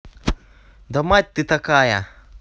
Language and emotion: Russian, angry